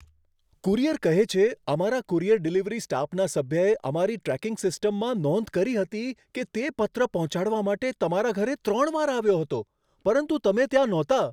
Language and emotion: Gujarati, surprised